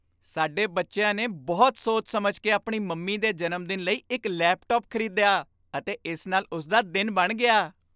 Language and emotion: Punjabi, happy